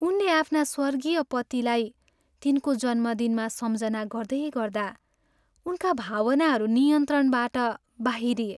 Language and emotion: Nepali, sad